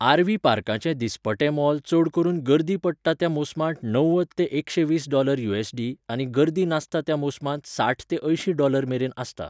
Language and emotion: Goan Konkani, neutral